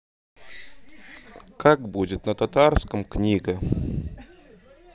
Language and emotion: Russian, neutral